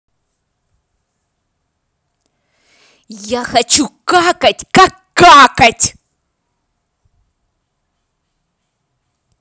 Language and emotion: Russian, angry